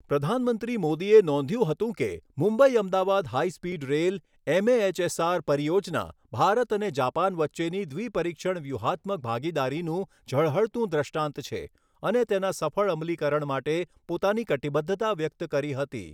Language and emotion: Gujarati, neutral